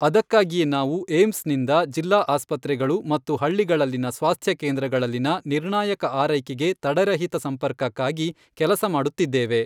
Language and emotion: Kannada, neutral